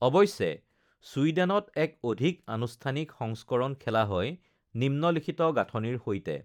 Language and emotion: Assamese, neutral